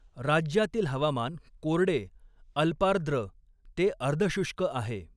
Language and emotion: Marathi, neutral